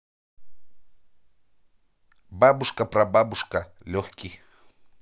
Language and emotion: Russian, neutral